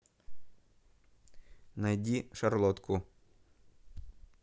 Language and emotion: Russian, neutral